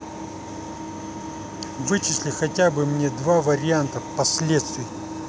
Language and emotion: Russian, angry